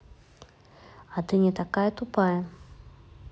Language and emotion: Russian, neutral